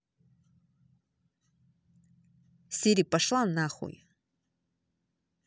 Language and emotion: Russian, angry